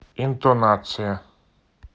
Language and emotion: Russian, neutral